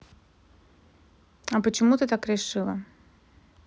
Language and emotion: Russian, neutral